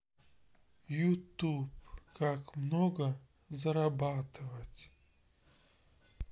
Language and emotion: Russian, sad